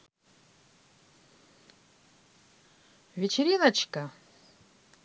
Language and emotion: Russian, positive